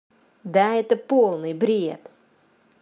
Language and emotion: Russian, angry